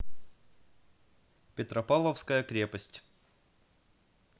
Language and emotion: Russian, neutral